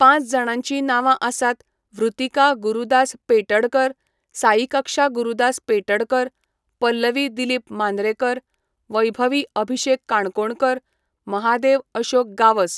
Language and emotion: Goan Konkani, neutral